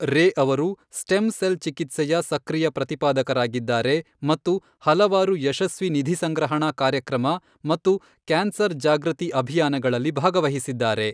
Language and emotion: Kannada, neutral